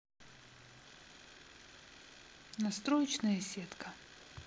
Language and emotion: Russian, neutral